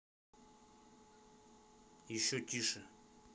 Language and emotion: Russian, neutral